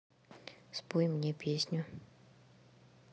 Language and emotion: Russian, neutral